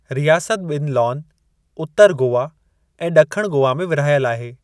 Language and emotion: Sindhi, neutral